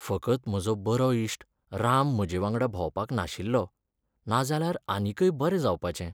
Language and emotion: Goan Konkani, sad